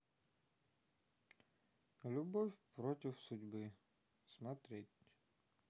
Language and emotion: Russian, neutral